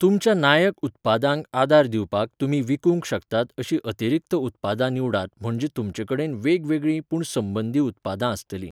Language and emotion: Goan Konkani, neutral